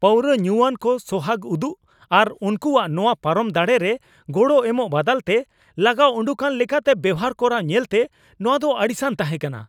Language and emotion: Santali, angry